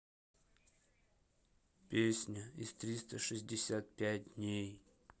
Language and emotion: Russian, sad